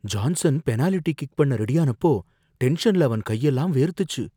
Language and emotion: Tamil, fearful